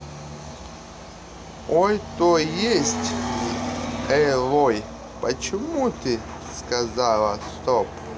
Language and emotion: Russian, neutral